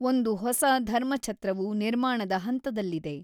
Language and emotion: Kannada, neutral